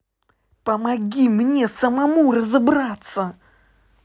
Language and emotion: Russian, angry